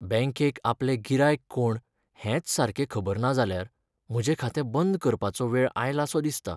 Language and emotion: Goan Konkani, sad